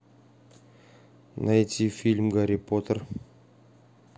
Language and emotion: Russian, neutral